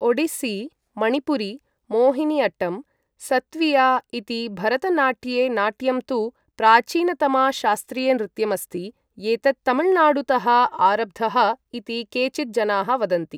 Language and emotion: Sanskrit, neutral